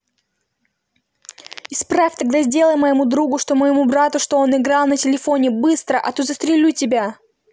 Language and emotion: Russian, angry